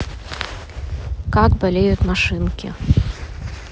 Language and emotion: Russian, neutral